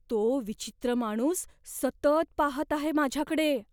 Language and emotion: Marathi, fearful